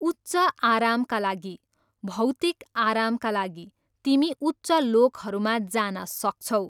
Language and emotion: Nepali, neutral